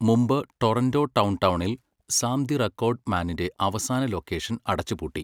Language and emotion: Malayalam, neutral